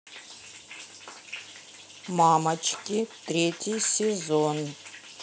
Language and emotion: Russian, neutral